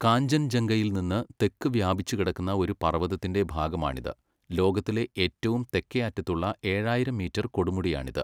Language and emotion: Malayalam, neutral